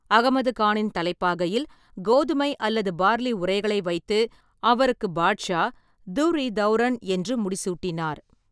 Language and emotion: Tamil, neutral